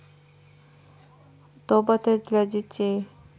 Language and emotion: Russian, neutral